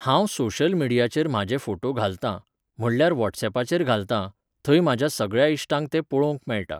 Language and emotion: Goan Konkani, neutral